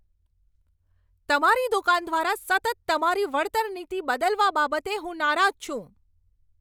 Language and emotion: Gujarati, angry